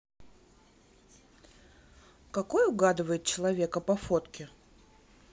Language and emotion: Russian, neutral